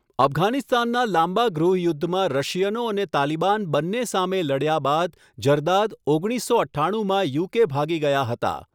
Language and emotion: Gujarati, neutral